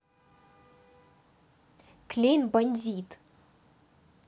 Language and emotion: Russian, angry